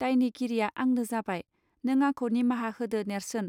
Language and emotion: Bodo, neutral